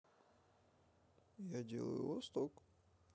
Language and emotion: Russian, neutral